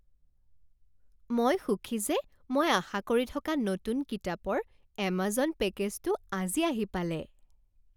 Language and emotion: Assamese, happy